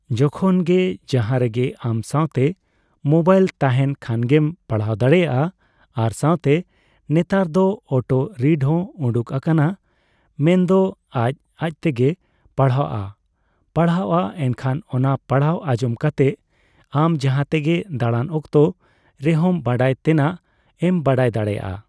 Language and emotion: Santali, neutral